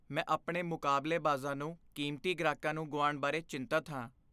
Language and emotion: Punjabi, fearful